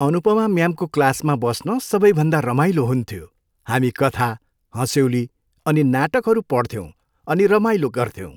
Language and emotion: Nepali, happy